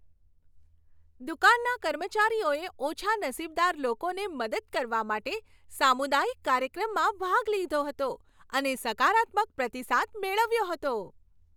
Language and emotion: Gujarati, happy